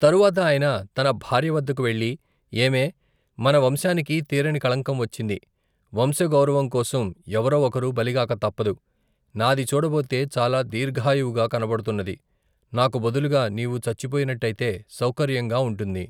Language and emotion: Telugu, neutral